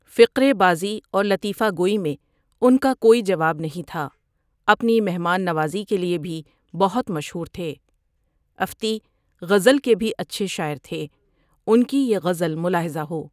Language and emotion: Urdu, neutral